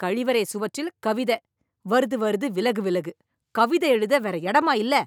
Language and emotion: Tamil, angry